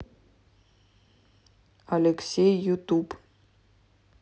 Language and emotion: Russian, neutral